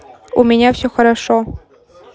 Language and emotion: Russian, neutral